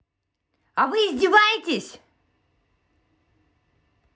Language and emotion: Russian, angry